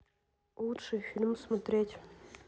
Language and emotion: Russian, neutral